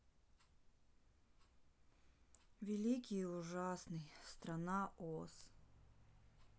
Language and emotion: Russian, sad